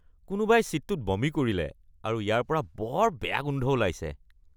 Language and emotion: Assamese, disgusted